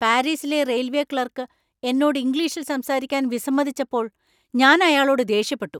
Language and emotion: Malayalam, angry